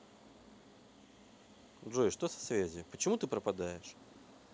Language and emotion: Russian, neutral